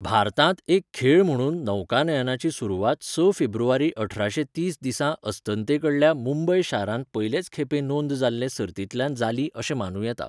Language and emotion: Goan Konkani, neutral